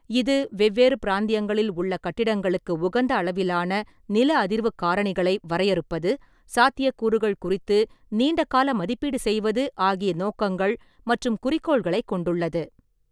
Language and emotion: Tamil, neutral